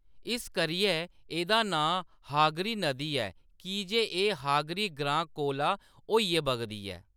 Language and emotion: Dogri, neutral